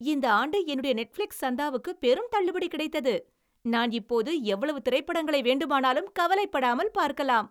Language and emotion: Tamil, happy